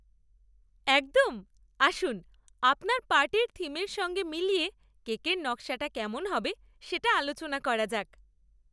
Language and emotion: Bengali, happy